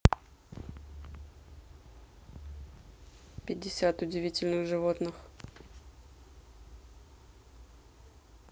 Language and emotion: Russian, neutral